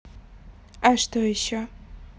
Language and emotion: Russian, neutral